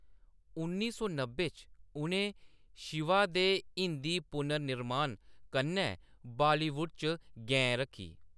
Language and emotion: Dogri, neutral